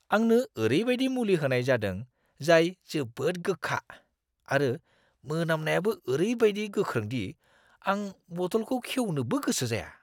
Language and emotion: Bodo, disgusted